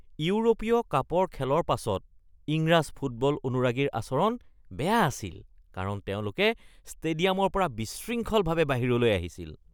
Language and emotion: Assamese, disgusted